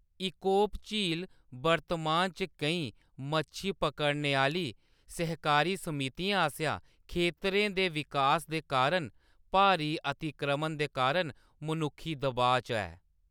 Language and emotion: Dogri, neutral